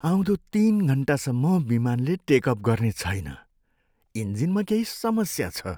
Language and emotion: Nepali, sad